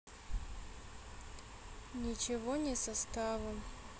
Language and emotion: Russian, sad